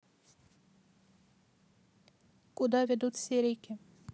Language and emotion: Russian, neutral